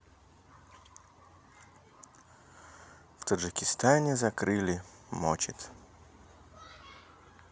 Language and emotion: Russian, neutral